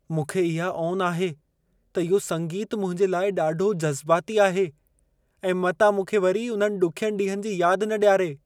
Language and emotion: Sindhi, fearful